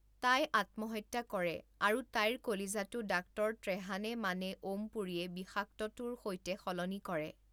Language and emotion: Assamese, neutral